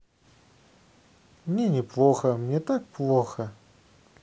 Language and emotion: Russian, sad